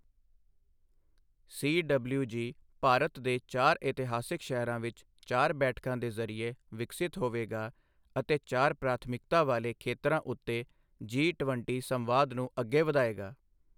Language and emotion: Punjabi, neutral